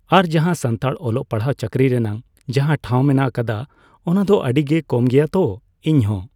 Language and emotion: Santali, neutral